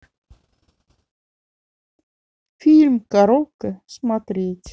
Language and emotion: Russian, neutral